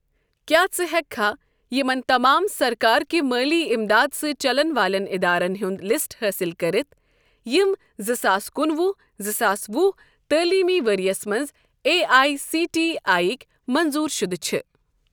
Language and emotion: Kashmiri, neutral